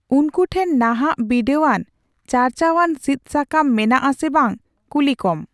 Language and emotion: Santali, neutral